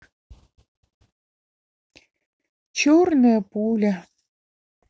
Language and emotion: Russian, sad